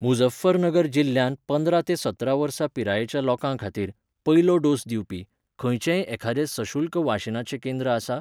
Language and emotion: Goan Konkani, neutral